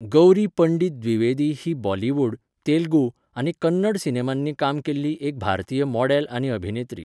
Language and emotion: Goan Konkani, neutral